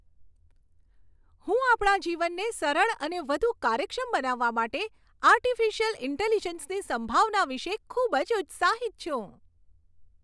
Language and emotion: Gujarati, happy